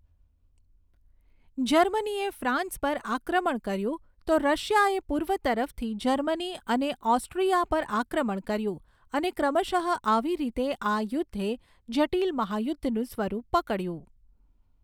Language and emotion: Gujarati, neutral